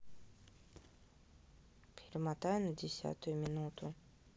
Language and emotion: Russian, neutral